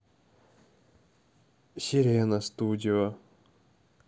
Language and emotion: Russian, neutral